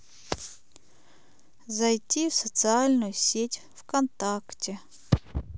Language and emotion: Russian, sad